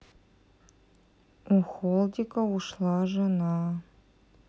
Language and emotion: Russian, neutral